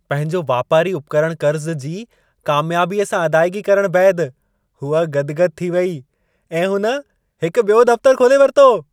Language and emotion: Sindhi, happy